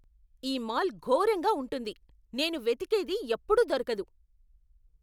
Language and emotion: Telugu, angry